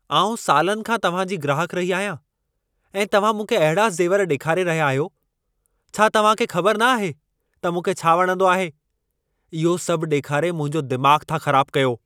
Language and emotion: Sindhi, angry